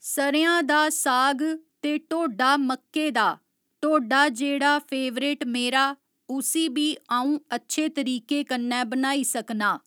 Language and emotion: Dogri, neutral